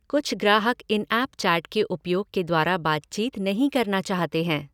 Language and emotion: Hindi, neutral